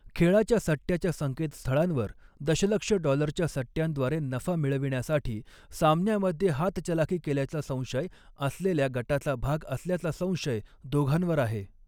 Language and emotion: Marathi, neutral